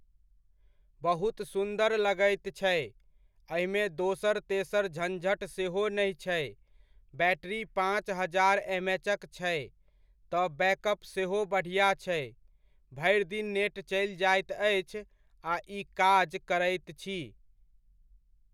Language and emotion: Maithili, neutral